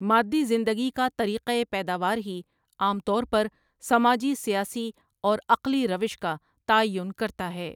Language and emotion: Urdu, neutral